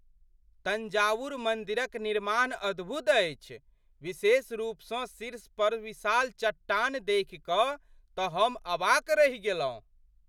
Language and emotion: Maithili, surprised